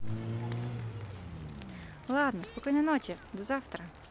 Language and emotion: Russian, positive